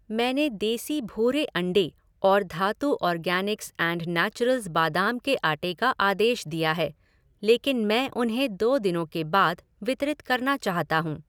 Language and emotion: Hindi, neutral